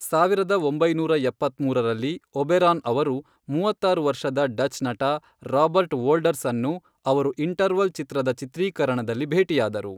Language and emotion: Kannada, neutral